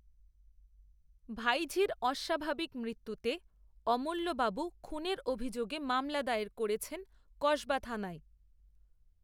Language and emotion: Bengali, neutral